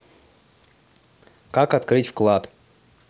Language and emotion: Russian, neutral